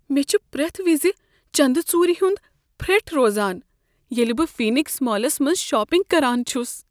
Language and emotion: Kashmiri, fearful